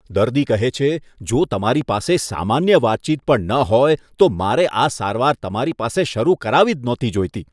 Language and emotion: Gujarati, disgusted